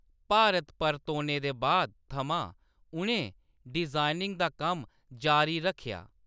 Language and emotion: Dogri, neutral